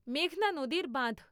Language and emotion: Bengali, neutral